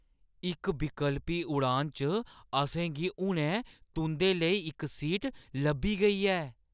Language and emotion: Dogri, surprised